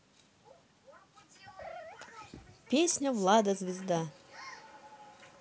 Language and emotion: Russian, neutral